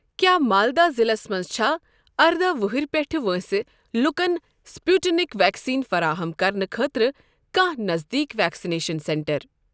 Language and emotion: Kashmiri, neutral